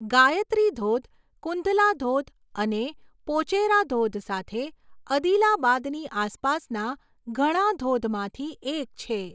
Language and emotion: Gujarati, neutral